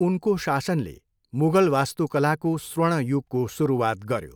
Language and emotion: Nepali, neutral